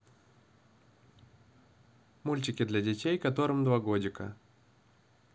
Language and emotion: Russian, neutral